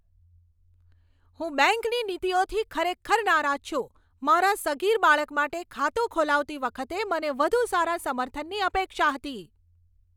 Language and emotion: Gujarati, angry